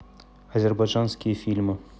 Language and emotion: Russian, neutral